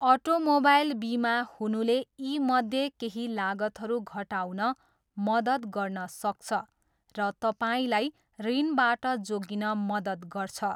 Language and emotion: Nepali, neutral